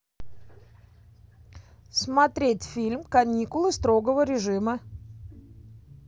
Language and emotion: Russian, positive